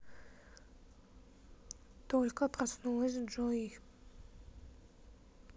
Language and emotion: Russian, neutral